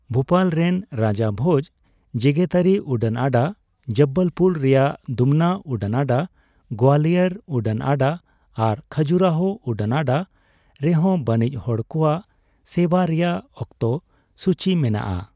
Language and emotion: Santali, neutral